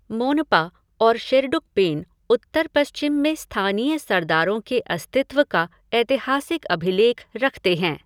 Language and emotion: Hindi, neutral